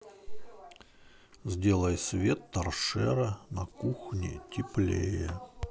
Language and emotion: Russian, neutral